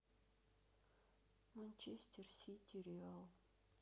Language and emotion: Russian, sad